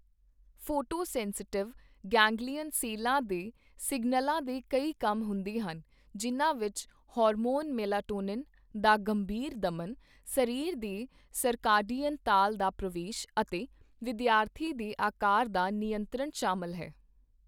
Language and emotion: Punjabi, neutral